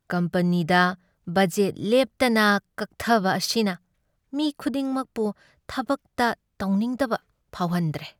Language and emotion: Manipuri, sad